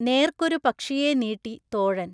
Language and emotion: Malayalam, neutral